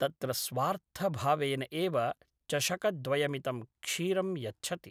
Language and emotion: Sanskrit, neutral